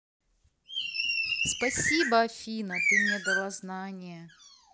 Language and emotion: Russian, positive